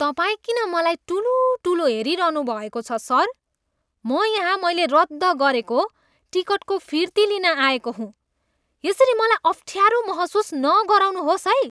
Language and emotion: Nepali, disgusted